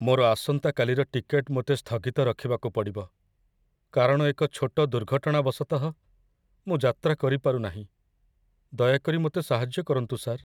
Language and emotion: Odia, sad